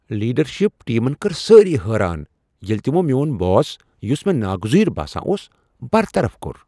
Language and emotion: Kashmiri, surprised